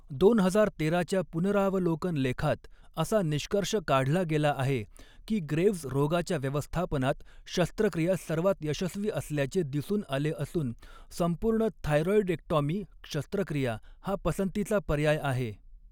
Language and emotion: Marathi, neutral